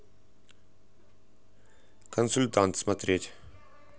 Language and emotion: Russian, neutral